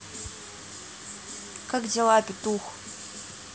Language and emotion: Russian, angry